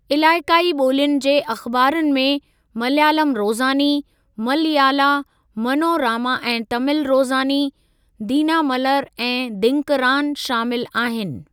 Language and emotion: Sindhi, neutral